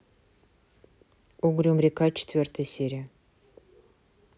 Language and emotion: Russian, neutral